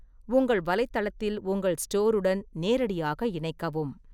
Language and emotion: Tamil, neutral